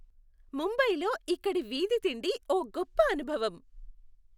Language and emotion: Telugu, happy